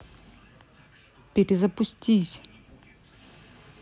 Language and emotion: Russian, neutral